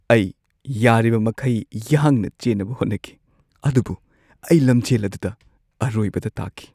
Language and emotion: Manipuri, sad